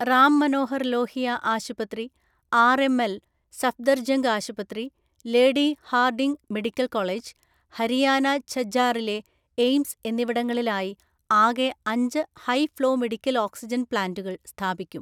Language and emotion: Malayalam, neutral